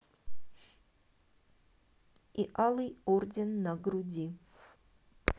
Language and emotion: Russian, neutral